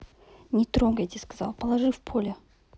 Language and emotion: Russian, neutral